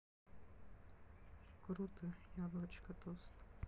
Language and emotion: Russian, sad